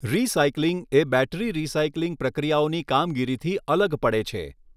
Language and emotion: Gujarati, neutral